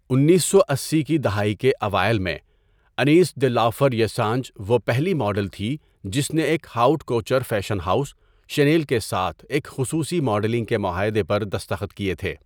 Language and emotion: Urdu, neutral